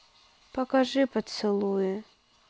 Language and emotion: Russian, sad